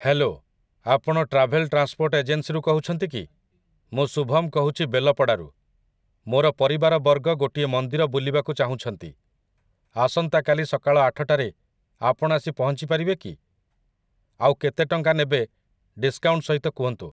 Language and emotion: Odia, neutral